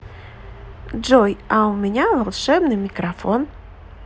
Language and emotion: Russian, positive